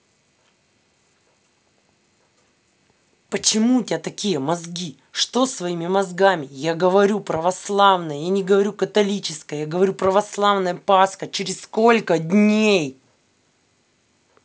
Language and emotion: Russian, angry